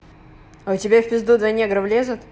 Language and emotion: Russian, neutral